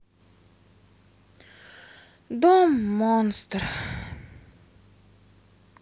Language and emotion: Russian, sad